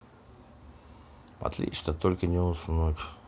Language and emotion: Russian, neutral